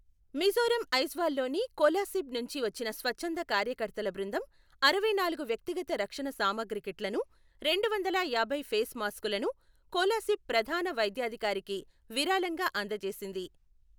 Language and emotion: Telugu, neutral